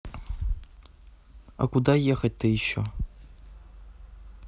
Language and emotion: Russian, neutral